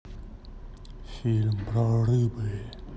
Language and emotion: Russian, neutral